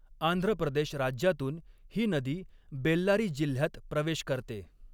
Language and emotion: Marathi, neutral